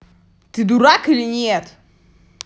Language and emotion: Russian, angry